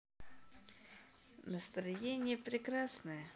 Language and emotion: Russian, positive